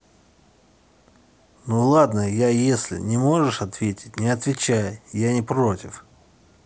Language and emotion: Russian, angry